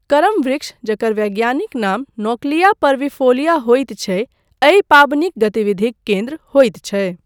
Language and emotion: Maithili, neutral